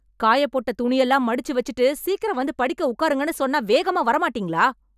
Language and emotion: Tamil, angry